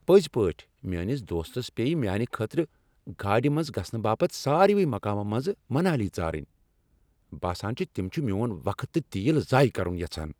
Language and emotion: Kashmiri, angry